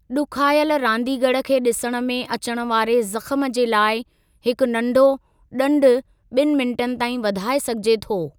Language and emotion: Sindhi, neutral